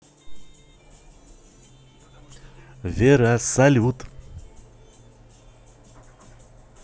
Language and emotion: Russian, positive